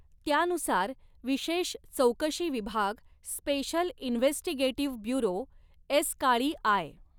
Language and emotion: Marathi, neutral